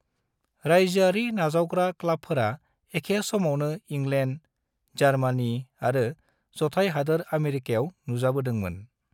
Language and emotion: Bodo, neutral